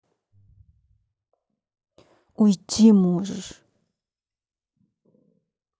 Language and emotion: Russian, angry